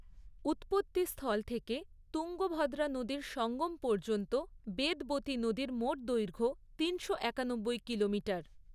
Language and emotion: Bengali, neutral